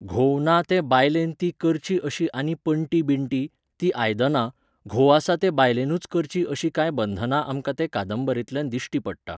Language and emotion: Goan Konkani, neutral